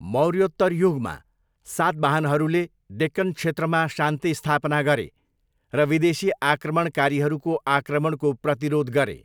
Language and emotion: Nepali, neutral